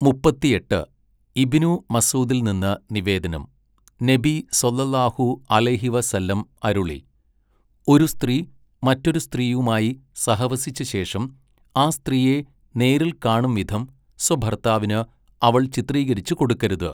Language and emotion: Malayalam, neutral